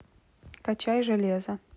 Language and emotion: Russian, neutral